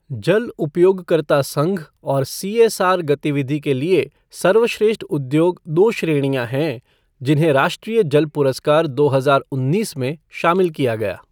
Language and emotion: Hindi, neutral